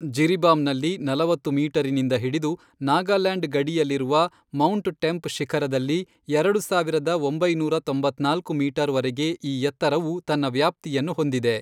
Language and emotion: Kannada, neutral